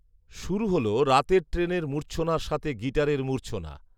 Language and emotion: Bengali, neutral